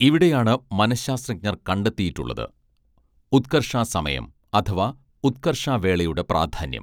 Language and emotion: Malayalam, neutral